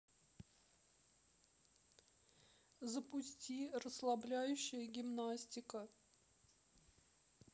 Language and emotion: Russian, sad